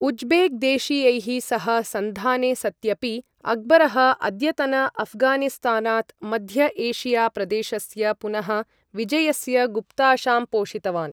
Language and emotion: Sanskrit, neutral